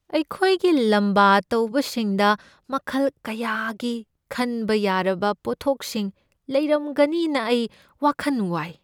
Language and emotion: Manipuri, fearful